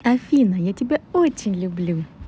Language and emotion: Russian, positive